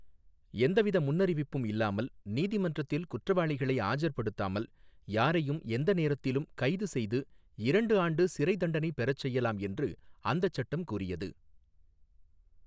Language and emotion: Tamil, neutral